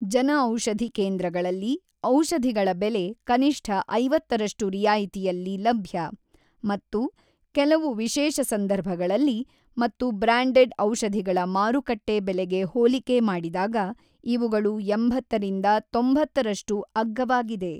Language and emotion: Kannada, neutral